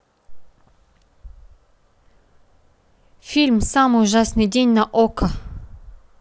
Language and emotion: Russian, neutral